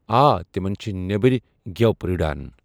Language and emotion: Kashmiri, neutral